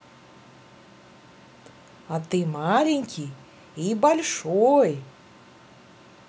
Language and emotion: Russian, neutral